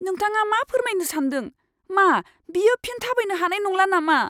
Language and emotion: Bodo, fearful